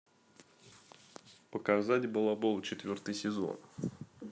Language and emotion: Russian, neutral